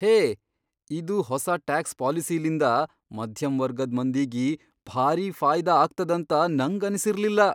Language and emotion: Kannada, surprised